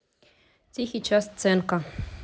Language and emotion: Russian, neutral